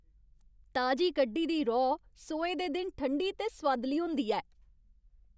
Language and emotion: Dogri, happy